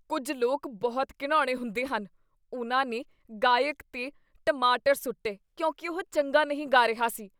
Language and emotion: Punjabi, disgusted